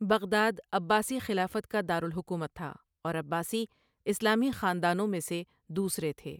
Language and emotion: Urdu, neutral